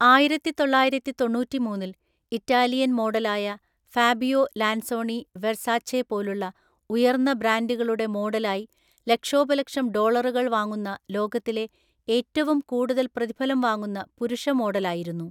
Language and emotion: Malayalam, neutral